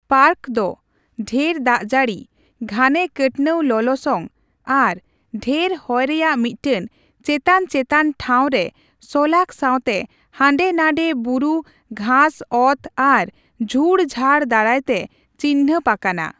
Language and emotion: Santali, neutral